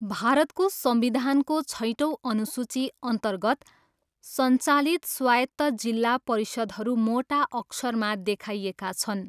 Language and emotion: Nepali, neutral